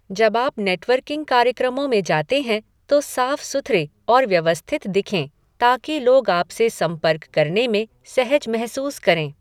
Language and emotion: Hindi, neutral